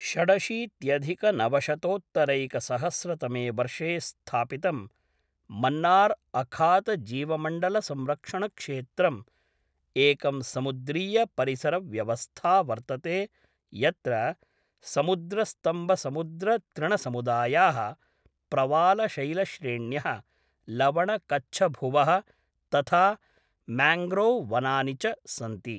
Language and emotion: Sanskrit, neutral